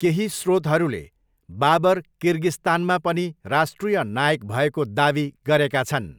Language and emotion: Nepali, neutral